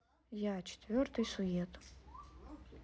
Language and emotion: Russian, neutral